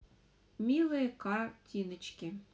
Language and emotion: Russian, neutral